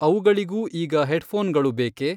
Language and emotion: Kannada, neutral